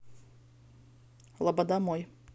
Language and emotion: Russian, neutral